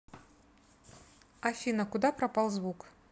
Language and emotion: Russian, neutral